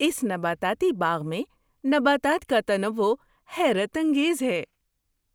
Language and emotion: Urdu, surprised